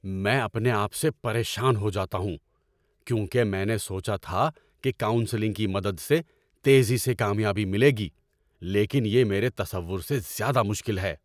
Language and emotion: Urdu, angry